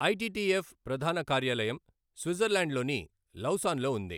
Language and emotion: Telugu, neutral